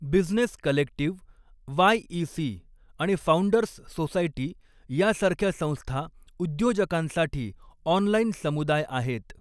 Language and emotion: Marathi, neutral